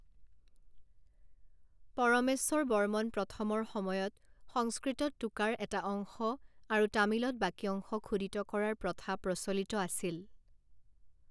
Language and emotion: Assamese, neutral